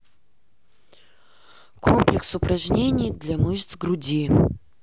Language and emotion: Russian, neutral